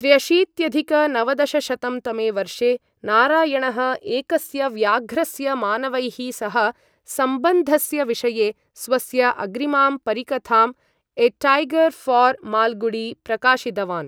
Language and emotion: Sanskrit, neutral